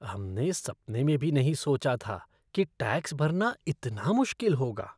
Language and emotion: Hindi, disgusted